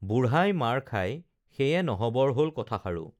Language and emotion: Assamese, neutral